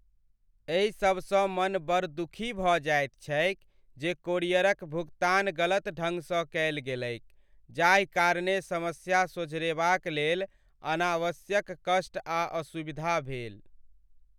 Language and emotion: Maithili, sad